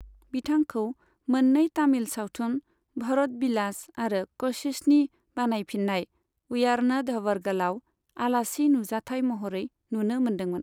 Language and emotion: Bodo, neutral